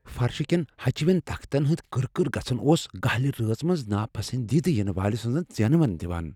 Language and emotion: Kashmiri, fearful